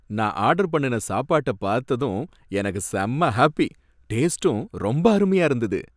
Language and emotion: Tamil, happy